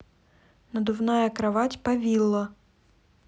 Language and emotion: Russian, neutral